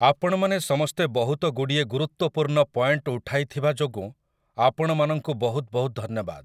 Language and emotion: Odia, neutral